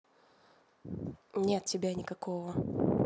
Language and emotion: Russian, neutral